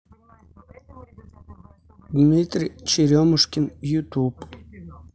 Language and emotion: Russian, neutral